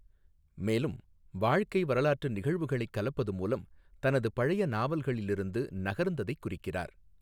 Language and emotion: Tamil, neutral